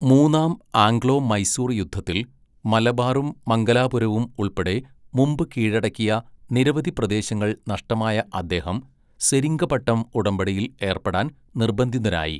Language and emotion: Malayalam, neutral